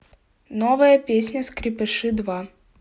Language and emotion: Russian, neutral